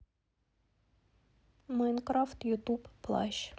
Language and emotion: Russian, neutral